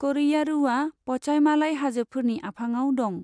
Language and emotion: Bodo, neutral